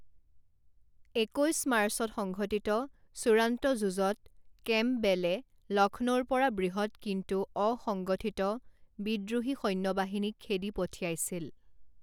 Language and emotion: Assamese, neutral